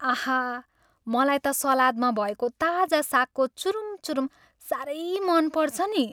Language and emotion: Nepali, happy